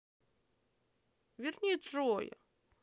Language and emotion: Russian, sad